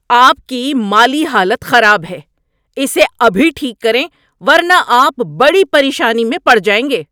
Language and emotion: Urdu, angry